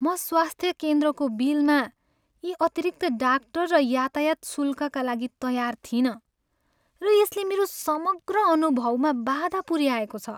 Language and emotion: Nepali, sad